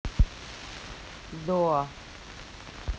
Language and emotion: Russian, neutral